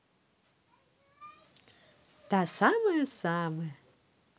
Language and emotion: Russian, positive